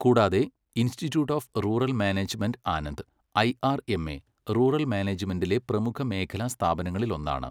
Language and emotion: Malayalam, neutral